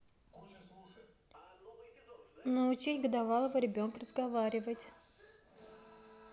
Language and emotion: Russian, neutral